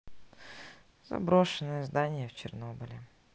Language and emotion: Russian, sad